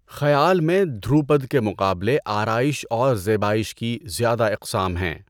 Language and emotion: Urdu, neutral